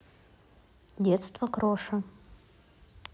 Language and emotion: Russian, neutral